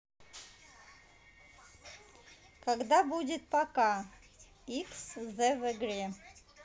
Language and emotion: Russian, neutral